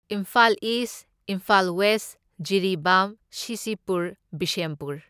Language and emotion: Manipuri, neutral